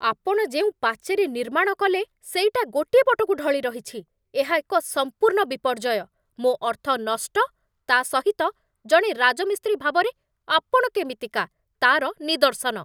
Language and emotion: Odia, angry